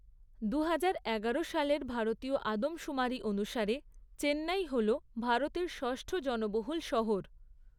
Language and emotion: Bengali, neutral